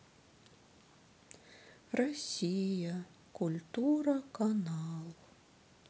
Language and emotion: Russian, sad